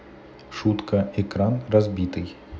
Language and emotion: Russian, neutral